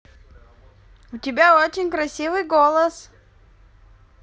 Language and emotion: Russian, positive